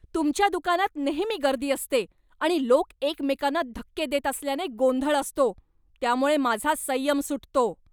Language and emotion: Marathi, angry